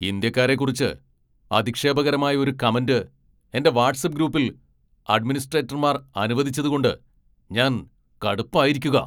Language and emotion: Malayalam, angry